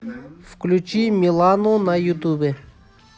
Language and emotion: Russian, neutral